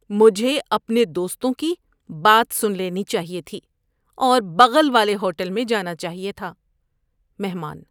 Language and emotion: Urdu, disgusted